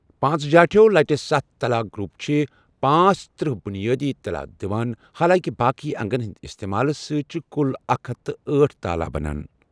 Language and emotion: Kashmiri, neutral